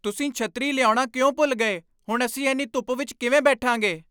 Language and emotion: Punjabi, angry